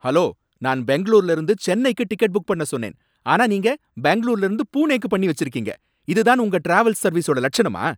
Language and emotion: Tamil, angry